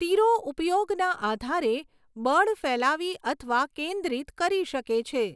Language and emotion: Gujarati, neutral